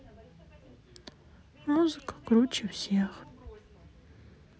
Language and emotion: Russian, sad